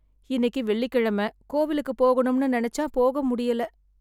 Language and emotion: Tamil, sad